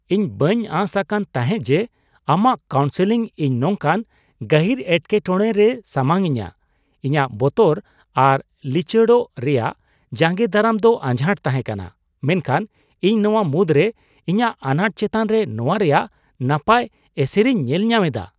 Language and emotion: Santali, surprised